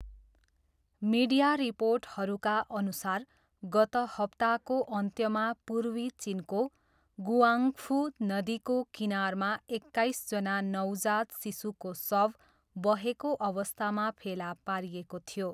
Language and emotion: Nepali, neutral